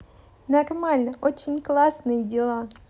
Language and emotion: Russian, positive